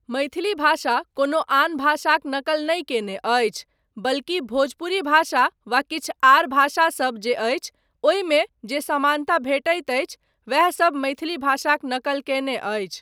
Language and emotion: Maithili, neutral